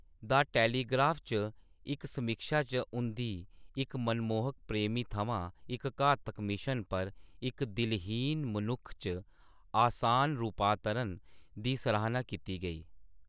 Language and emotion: Dogri, neutral